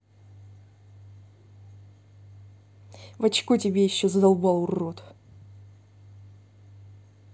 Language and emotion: Russian, angry